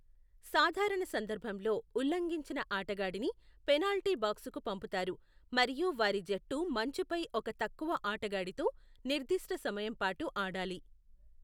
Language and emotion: Telugu, neutral